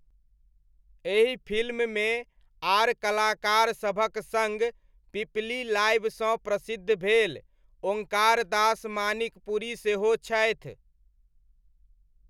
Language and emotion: Maithili, neutral